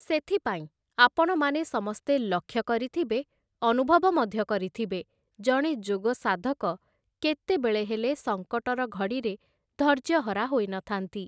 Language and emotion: Odia, neutral